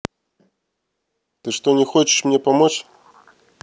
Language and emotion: Russian, neutral